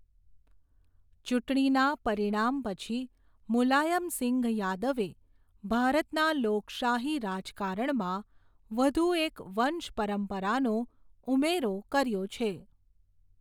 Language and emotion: Gujarati, neutral